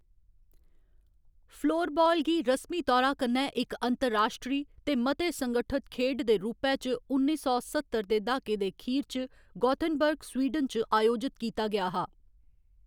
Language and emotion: Dogri, neutral